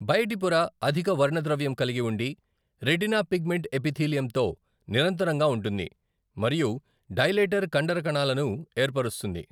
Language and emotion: Telugu, neutral